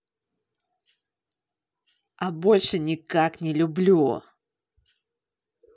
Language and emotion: Russian, angry